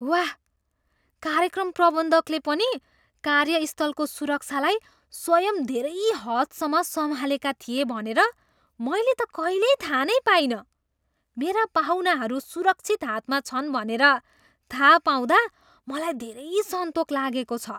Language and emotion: Nepali, surprised